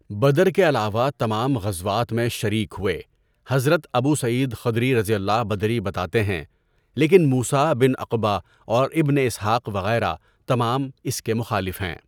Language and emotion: Urdu, neutral